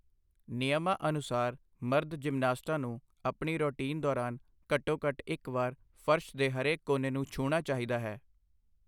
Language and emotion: Punjabi, neutral